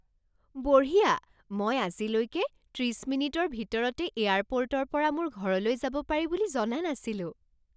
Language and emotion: Assamese, surprised